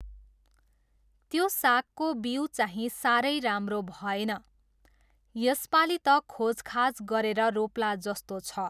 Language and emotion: Nepali, neutral